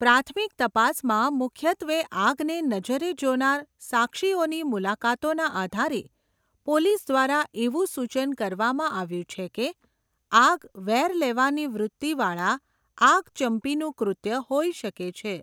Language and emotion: Gujarati, neutral